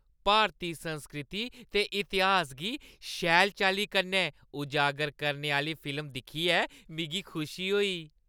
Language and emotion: Dogri, happy